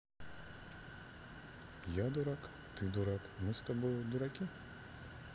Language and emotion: Russian, neutral